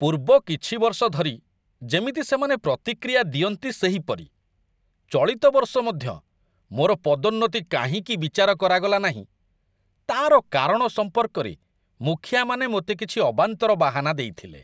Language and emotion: Odia, disgusted